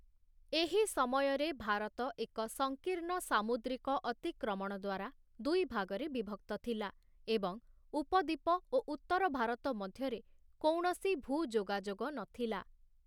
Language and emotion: Odia, neutral